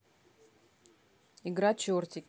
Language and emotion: Russian, neutral